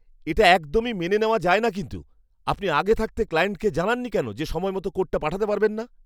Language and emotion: Bengali, angry